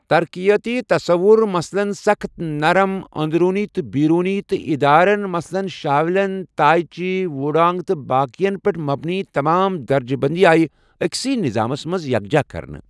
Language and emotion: Kashmiri, neutral